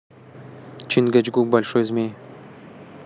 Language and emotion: Russian, neutral